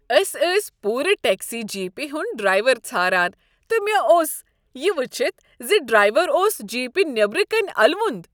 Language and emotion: Kashmiri, happy